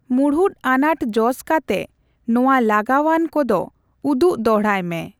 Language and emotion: Santali, neutral